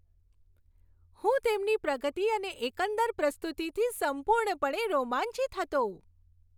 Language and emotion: Gujarati, happy